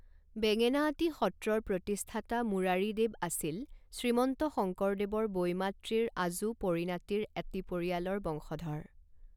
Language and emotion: Assamese, neutral